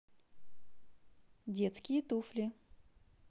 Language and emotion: Russian, positive